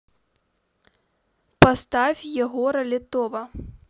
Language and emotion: Russian, neutral